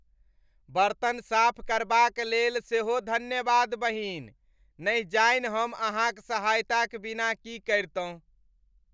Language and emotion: Maithili, happy